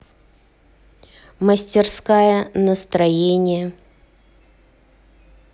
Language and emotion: Russian, neutral